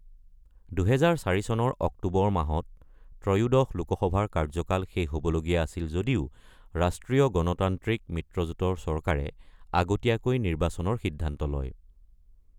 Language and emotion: Assamese, neutral